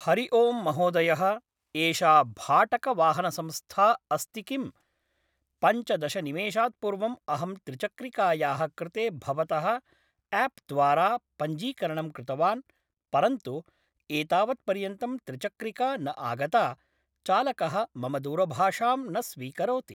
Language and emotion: Sanskrit, neutral